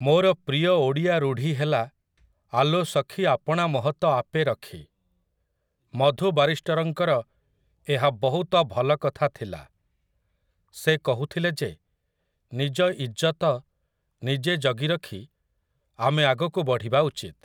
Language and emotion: Odia, neutral